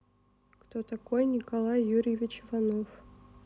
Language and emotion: Russian, neutral